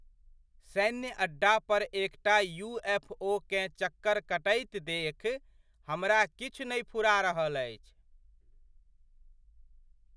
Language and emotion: Maithili, surprised